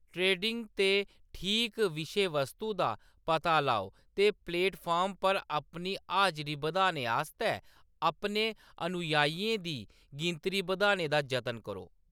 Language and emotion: Dogri, neutral